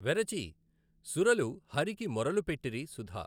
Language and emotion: Telugu, neutral